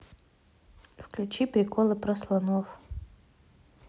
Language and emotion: Russian, neutral